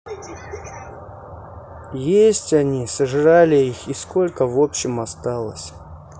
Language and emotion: Russian, sad